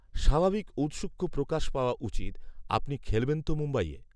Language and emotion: Bengali, neutral